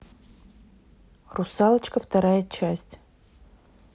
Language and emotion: Russian, neutral